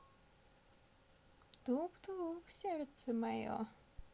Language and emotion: Russian, positive